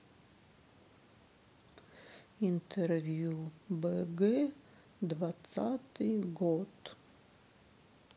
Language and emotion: Russian, sad